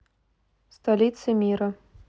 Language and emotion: Russian, neutral